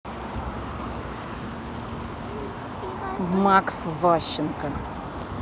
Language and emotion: Russian, neutral